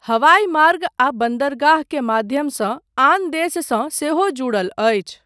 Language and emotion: Maithili, neutral